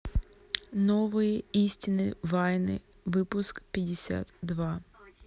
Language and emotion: Russian, neutral